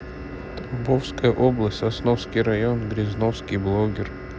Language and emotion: Russian, neutral